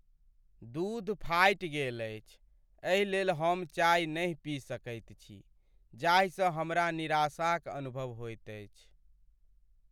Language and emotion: Maithili, sad